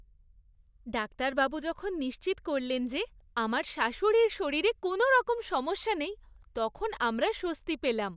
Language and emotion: Bengali, happy